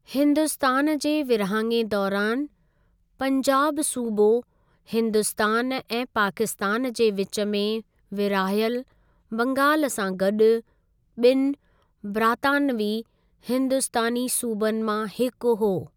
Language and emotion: Sindhi, neutral